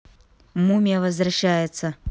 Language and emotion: Russian, neutral